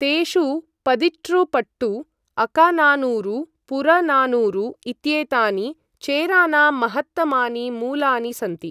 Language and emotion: Sanskrit, neutral